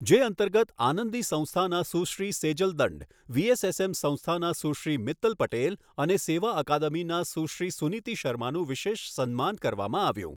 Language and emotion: Gujarati, neutral